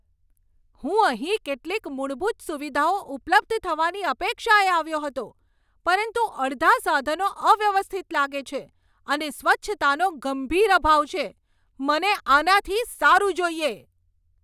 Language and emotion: Gujarati, angry